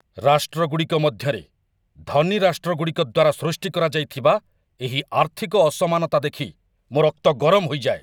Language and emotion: Odia, angry